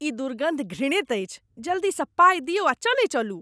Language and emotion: Maithili, disgusted